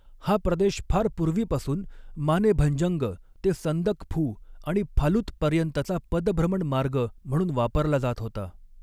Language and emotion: Marathi, neutral